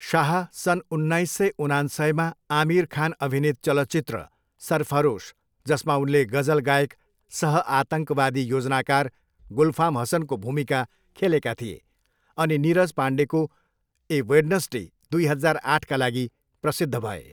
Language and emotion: Nepali, neutral